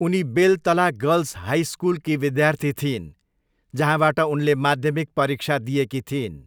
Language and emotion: Nepali, neutral